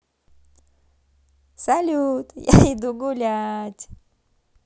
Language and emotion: Russian, positive